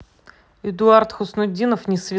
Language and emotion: Russian, neutral